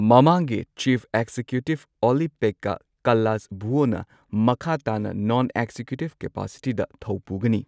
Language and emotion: Manipuri, neutral